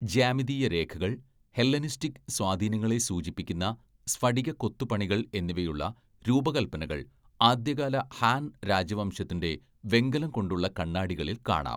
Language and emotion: Malayalam, neutral